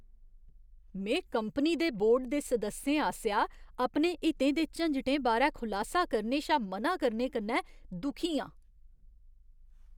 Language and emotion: Dogri, disgusted